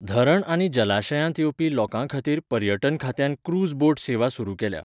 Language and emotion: Goan Konkani, neutral